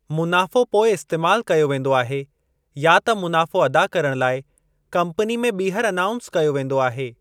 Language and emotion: Sindhi, neutral